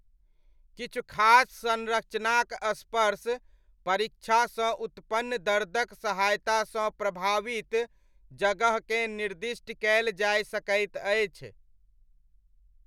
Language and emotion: Maithili, neutral